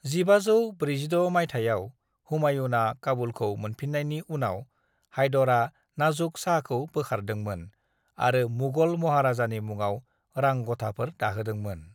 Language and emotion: Bodo, neutral